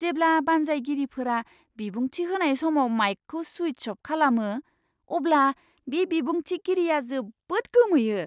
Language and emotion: Bodo, surprised